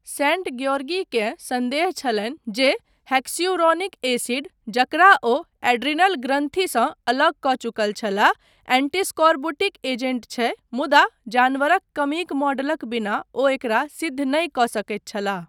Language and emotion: Maithili, neutral